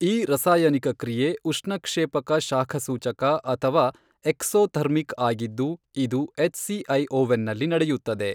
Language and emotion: Kannada, neutral